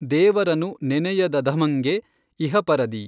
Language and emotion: Kannada, neutral